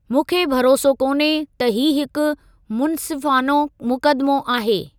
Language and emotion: Sindhi, neutral